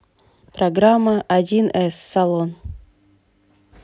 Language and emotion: Russian, neutral